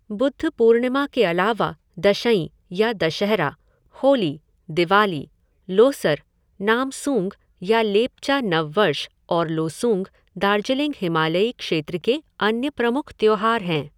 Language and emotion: Hindi, neutral